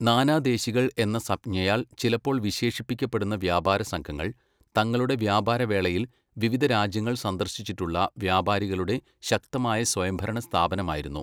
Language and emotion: Malayalam, neutral